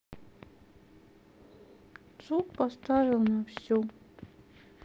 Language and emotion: Russian, sad